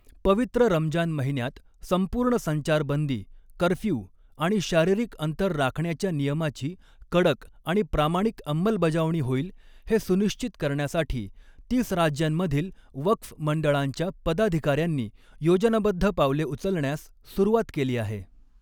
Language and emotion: Marathi, neutral